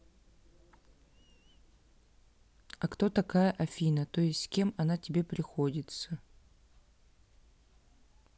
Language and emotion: Russian, neutral